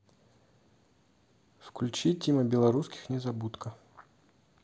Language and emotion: Russian, neutral